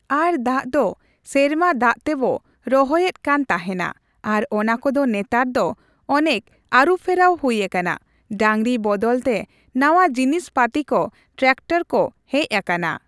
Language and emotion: Santali, neutral